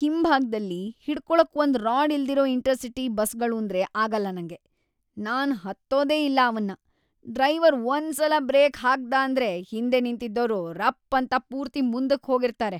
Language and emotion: Kannada, disgusted